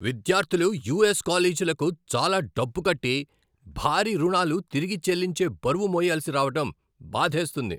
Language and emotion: Telugu, angry